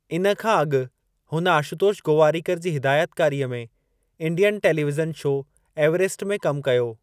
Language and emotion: Sindhi, neutral